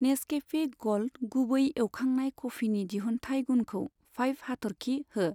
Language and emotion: Bodo, neutral